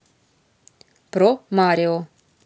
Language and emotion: Russian, neutral